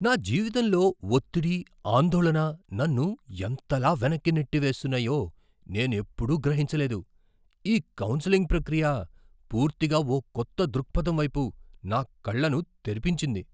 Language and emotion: Telugu, surprised